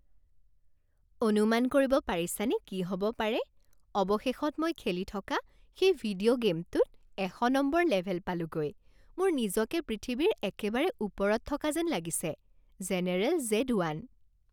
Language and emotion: Assamese, happy